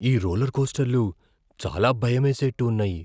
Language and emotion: Telugu, fearful